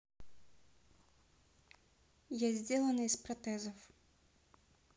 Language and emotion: Russian, neutral